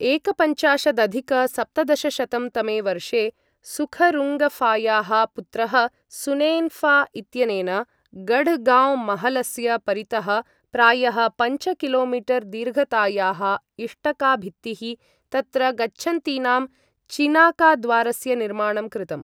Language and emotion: Sanskrit, neutral